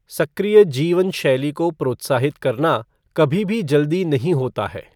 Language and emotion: Hindi, neutral